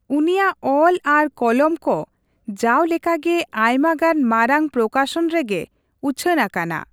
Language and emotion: Santali, neutral